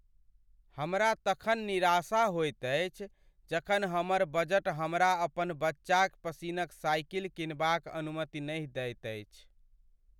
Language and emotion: Maithili, sad